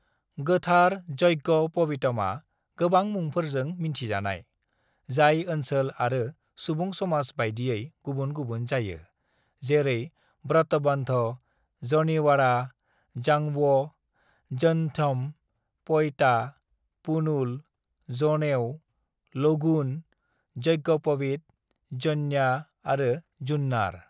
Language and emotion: Bodo, neutral